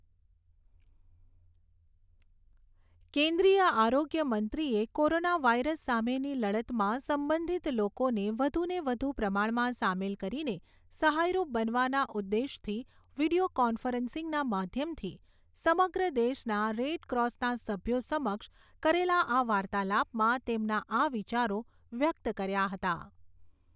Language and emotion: Gujarati, neutral